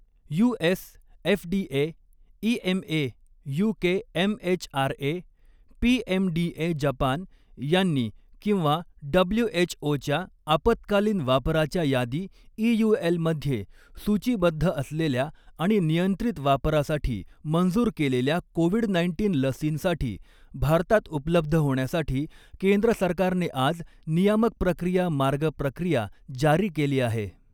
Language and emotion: Marathi, neutral